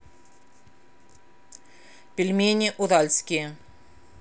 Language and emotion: Russian, neutral